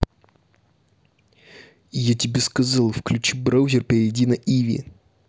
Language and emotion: Russian, angry